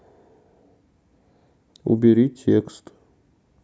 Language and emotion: Russian, neutral